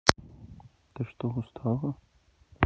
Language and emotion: Russian, neutral